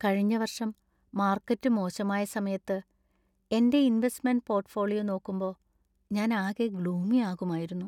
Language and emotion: Malayalam, sad